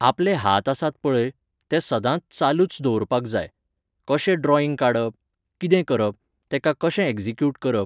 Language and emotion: Goan Konkani, neutral